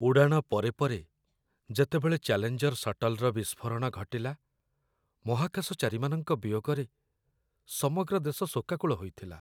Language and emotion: Odia, sad